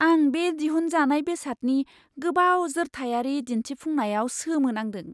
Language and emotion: Bodo, surprised